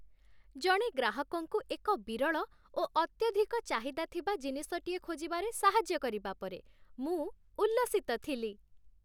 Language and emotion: Odia, happy